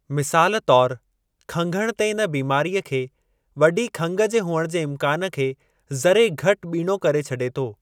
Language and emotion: Sindhi, neutral